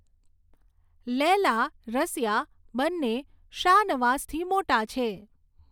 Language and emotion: Gujarati, neutral